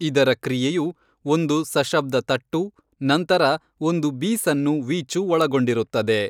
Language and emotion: Kannada, neutral